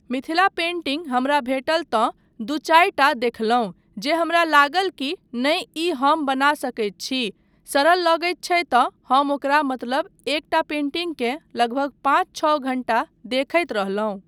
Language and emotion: Maithili, neutral